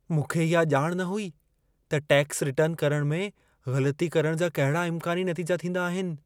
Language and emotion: Sindhi, fearful